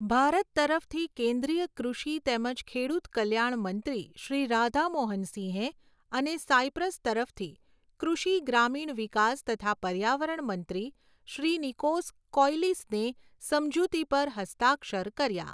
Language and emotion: Gujarati, neutral